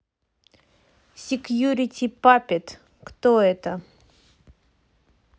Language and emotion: Russian, neutral